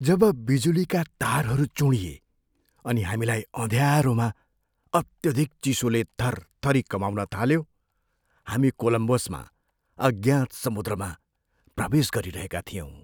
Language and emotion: Nepali, fearful